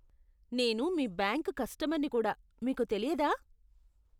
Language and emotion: Telugu, disgusted